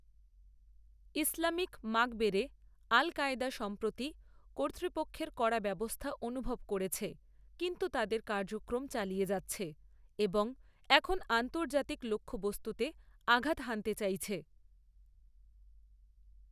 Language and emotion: Bengali, neutral